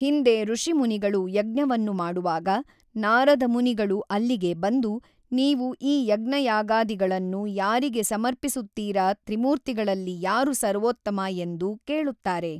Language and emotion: Kannada, neutral